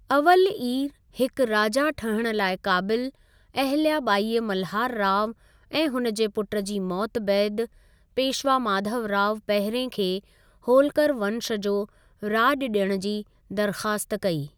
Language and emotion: Sindhi, neutral